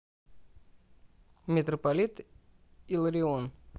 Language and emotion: Russian, neutral